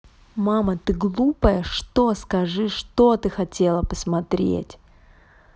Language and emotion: Russian, angry